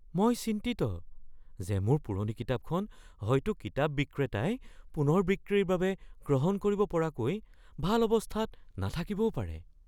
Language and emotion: Assamese, fearful